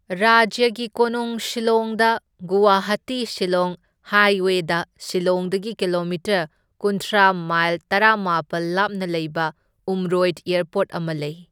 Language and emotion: Manipuri, neutral